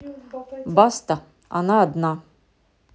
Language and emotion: Russian, neutral